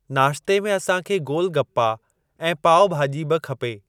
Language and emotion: Sindhi, neutral